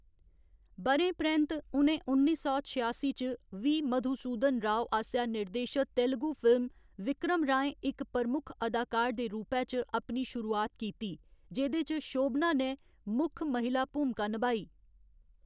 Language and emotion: Dogri, neutral